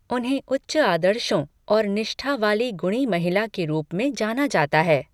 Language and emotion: Hindi, neutral